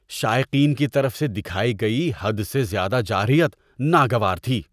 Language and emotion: Urdu, disgusted